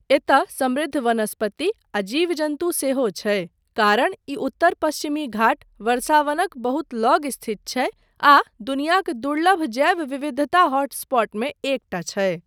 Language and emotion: Maithili, neutral